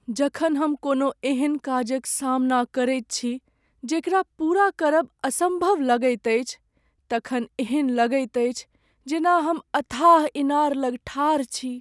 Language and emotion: Maithili, sad